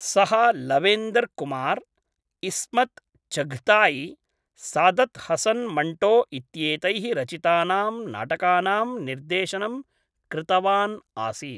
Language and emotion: Sanskrit, neutral